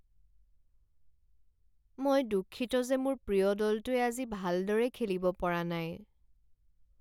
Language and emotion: Assamese, sad